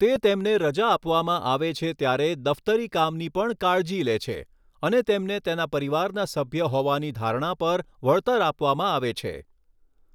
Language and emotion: Gujarati, neutral